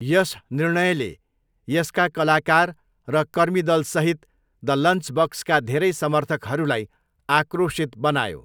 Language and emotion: Nepali, neutral